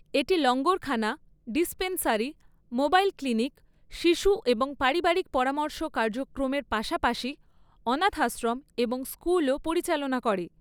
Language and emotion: Bengali, neutral